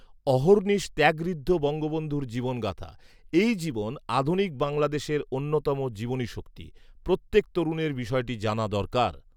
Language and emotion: Bengali, neutral